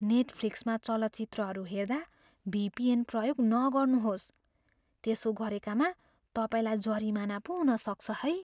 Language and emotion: Nepali, fearful